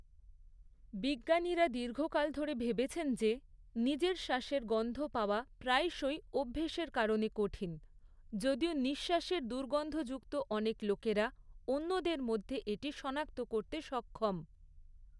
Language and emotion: Bengali, neutral